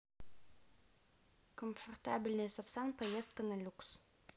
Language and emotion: Russian, neutral